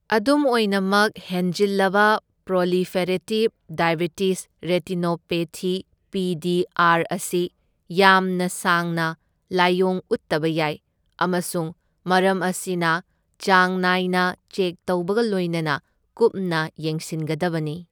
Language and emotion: Manipuri, neutral